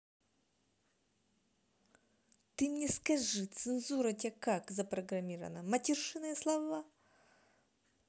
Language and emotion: Russian, angry